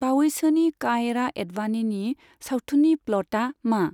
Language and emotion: Bodo, neutral